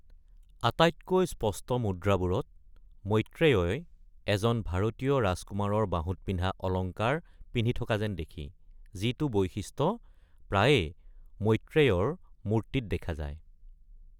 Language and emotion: Assamese, neutral